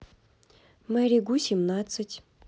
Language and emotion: Russian, neutral